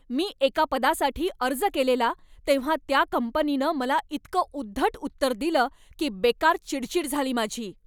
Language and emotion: Marathi, angry